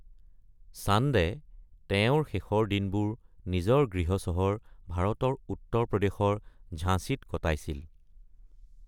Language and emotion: Assamese, neutral